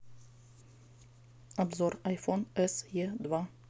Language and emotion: Russian, neutral